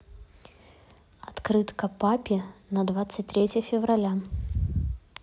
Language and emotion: Russian, neutral